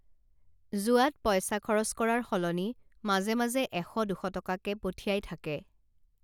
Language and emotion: Assamese, neutral